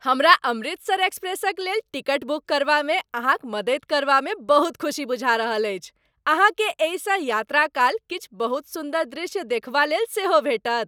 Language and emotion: Maithili, happy